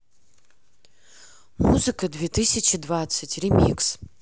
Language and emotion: Russian, neutral